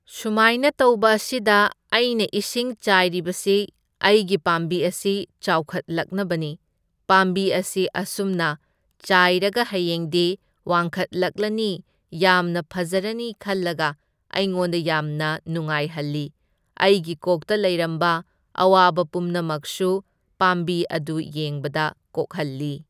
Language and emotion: Manipuri, neutral